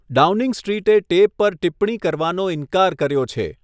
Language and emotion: Gujarati, neutral